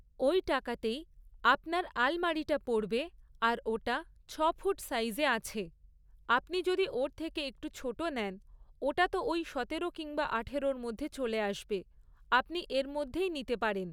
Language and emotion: Bengali, neutral